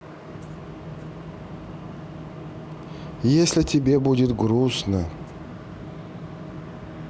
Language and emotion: Russian, sad